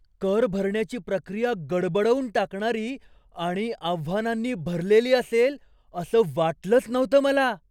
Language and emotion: Marathi, surprised